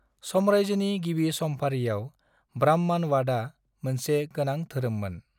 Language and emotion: Bodo, neutral